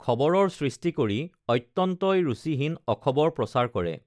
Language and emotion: Assamese, neutral